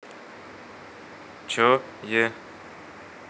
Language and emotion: Russian, neutral